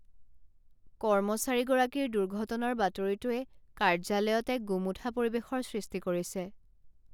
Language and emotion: Assamese, sad